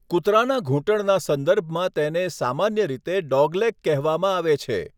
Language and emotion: Gujarati, neutral